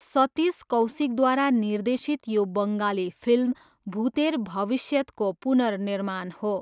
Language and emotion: Nepali, neutral